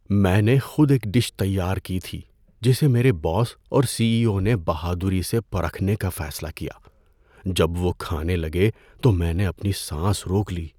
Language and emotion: Urdu, fearful